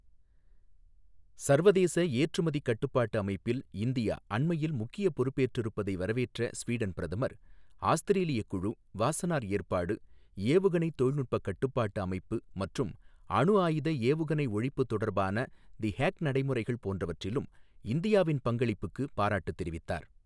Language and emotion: Tamil, neutral